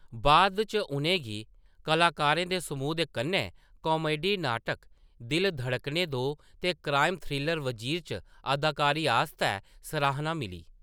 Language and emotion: Dogri, neutral